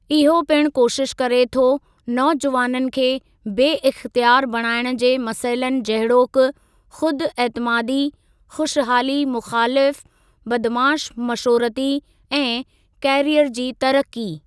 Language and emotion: Sindhi, neutral